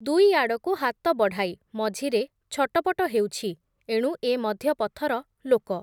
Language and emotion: Odia, neutral